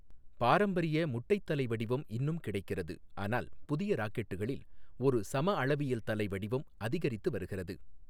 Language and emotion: Tamil, neutral